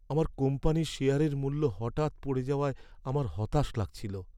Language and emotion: Bengali, sad